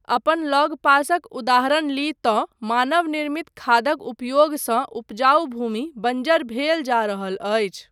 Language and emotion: Maithili, neutral